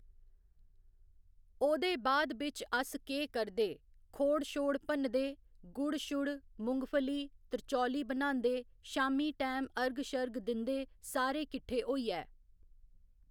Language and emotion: Dogri, neutral